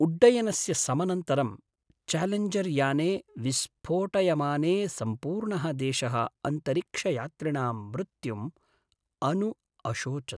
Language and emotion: Sanskrit, sad